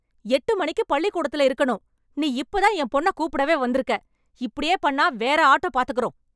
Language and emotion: Tamil, angry